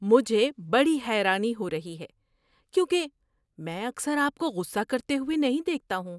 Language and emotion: Urdu, surprised